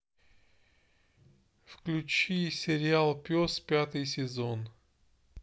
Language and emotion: Russian, neutral